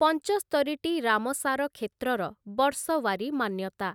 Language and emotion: Odia, neutral